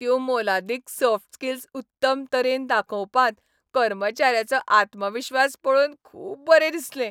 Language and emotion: Goan Konkani, happy